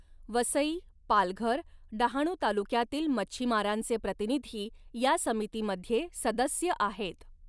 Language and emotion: Marathi, neutral